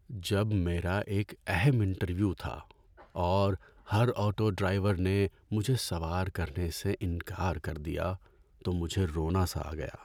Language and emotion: Urdu, sad